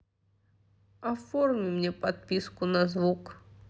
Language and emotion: Russian, sad